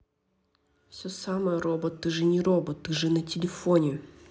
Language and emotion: Russian, neutral